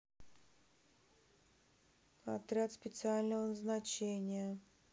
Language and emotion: Russian, neutral